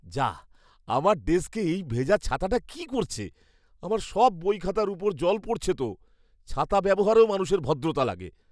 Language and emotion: Bengali, disgusted